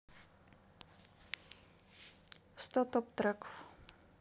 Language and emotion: Russian, neutral